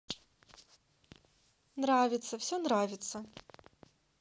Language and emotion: Russian, positive